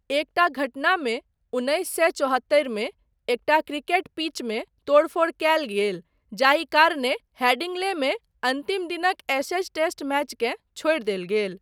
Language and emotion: Maithili, neutral